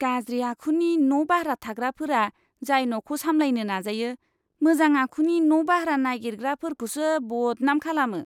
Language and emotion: Bodo, disgusted